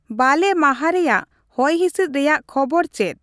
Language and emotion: Santali, neutral